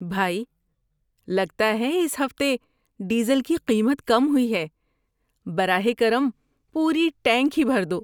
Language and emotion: Urdu, happy